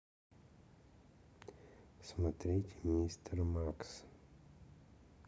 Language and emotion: Russian, neutral